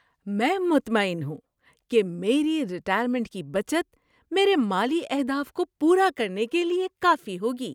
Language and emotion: Urdu, happy